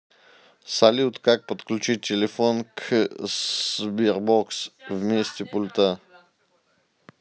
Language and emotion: Russian, neutral